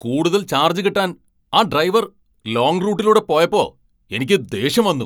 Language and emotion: Malayalam, angry